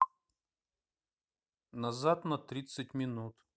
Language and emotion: Russian, neutral